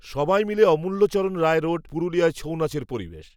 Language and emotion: Bengali, neutral